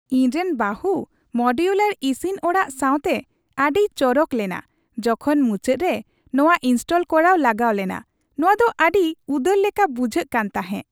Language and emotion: Santali, happy